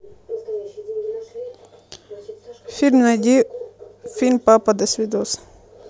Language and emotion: Russian, neutral